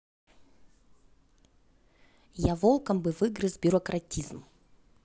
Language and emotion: Russian, neutral